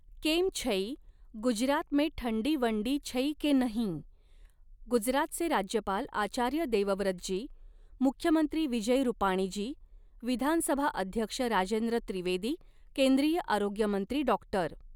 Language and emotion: Marathi, neutral